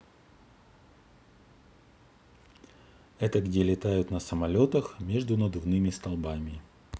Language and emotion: Russian, neutral